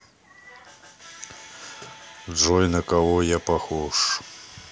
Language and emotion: Russian, neutral